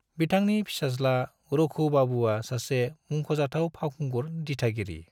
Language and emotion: Bodo, neutral